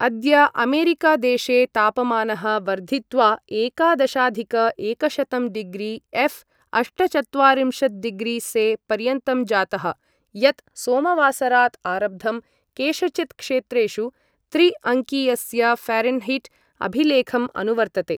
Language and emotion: Sanskrit, neutral